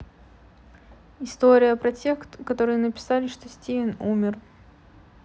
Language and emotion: Russian, neutral